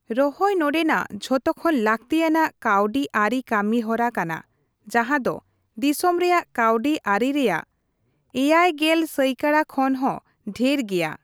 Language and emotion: Santali, neutral